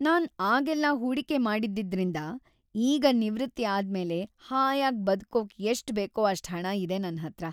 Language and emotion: Kannada, happy